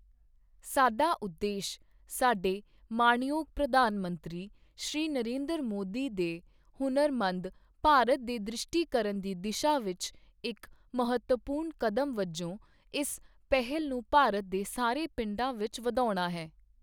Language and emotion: Punjabi, neutral